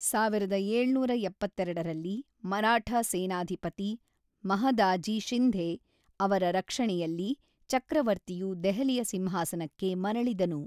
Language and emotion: Kannada, neutral